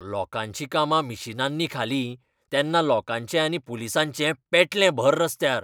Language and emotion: Goan Konkani, angry